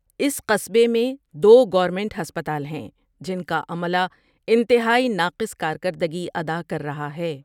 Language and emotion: Urdu, neutral